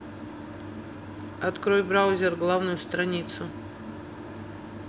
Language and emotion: Russian, neutral